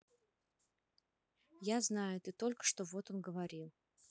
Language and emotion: Russian, neutral